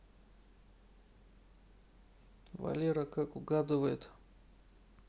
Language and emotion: Russian, neutral